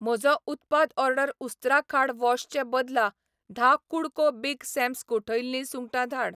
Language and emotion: Goan Konkani, neutral